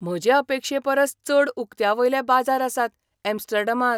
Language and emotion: Goan Konkani, surprised